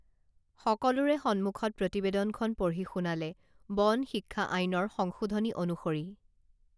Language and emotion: Assamese, neutral